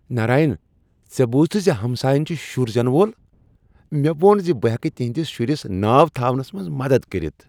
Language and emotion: Kashmiri, happy